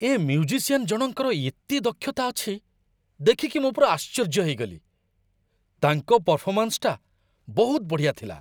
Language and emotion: Odia, surprised